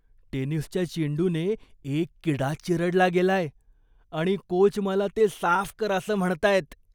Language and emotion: Marathi, disgusted